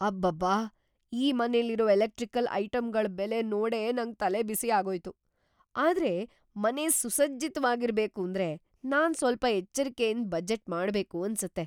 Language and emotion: Kannada, surprised